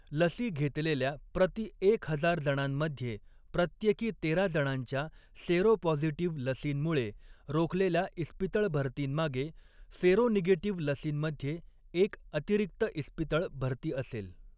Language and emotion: Marathi, neutral